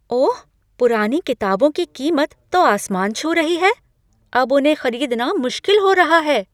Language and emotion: Hindi, surprised